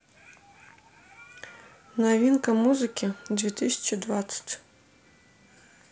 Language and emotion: Russian, neutral